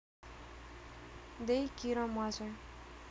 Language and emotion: Russian, neutral